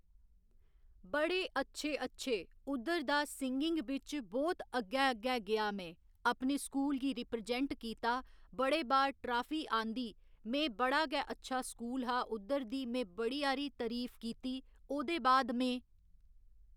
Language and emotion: Dogri, neutral